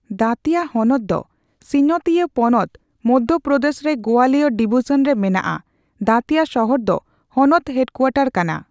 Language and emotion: Santali, neutral